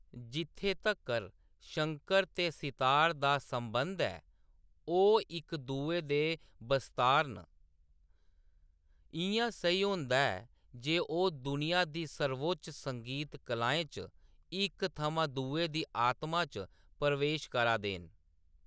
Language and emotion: Dogri, neutral